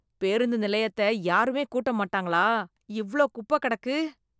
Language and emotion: Tamil, disgusted